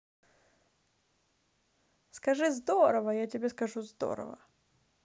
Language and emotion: Russian, positive